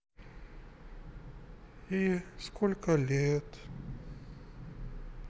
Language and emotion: Russian, sad